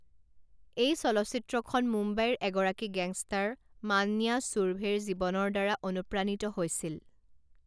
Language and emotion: Assamese, neutral